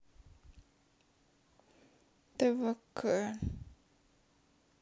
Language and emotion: Russian, sad